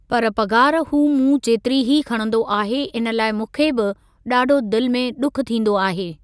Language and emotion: Sindhi, neutral